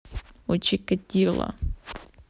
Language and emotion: Russian, neutral